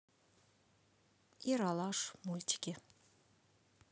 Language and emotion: Russian, neutral